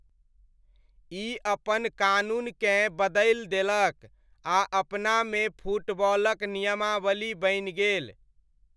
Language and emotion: Maithili, neutral